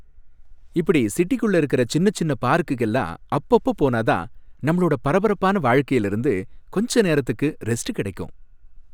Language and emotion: Tamil, happy